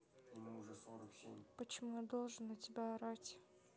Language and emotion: Russian, neutral